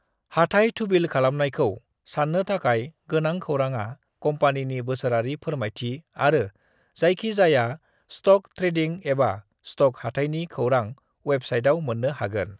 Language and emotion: Bodo, neutral